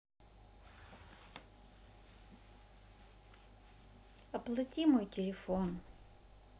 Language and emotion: Russian, sad